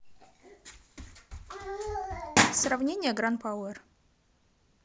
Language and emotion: Russian, neutral